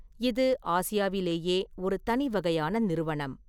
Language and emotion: Tamil, neutral